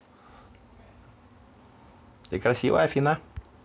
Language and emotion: Russian, positive